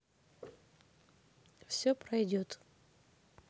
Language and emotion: Russian, neutral